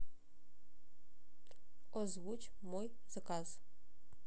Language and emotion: Russian, neutral